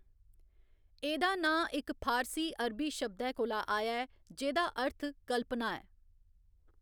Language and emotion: Dogri, neutral